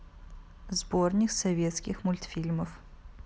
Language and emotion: Russian, neutral